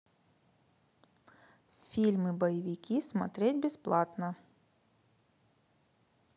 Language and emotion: Russian, neutral